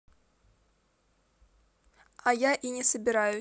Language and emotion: Russian, angry